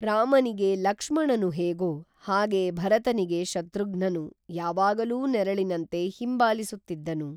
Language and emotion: Kannada, neutral